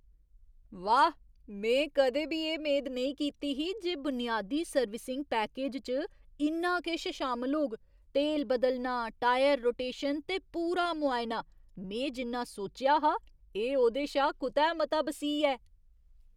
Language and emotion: Dogri, surprised